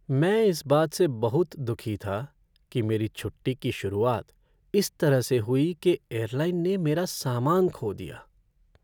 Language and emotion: Hindi, sad